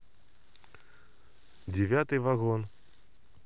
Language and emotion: Russian, neutral